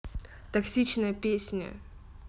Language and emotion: Russian, neutral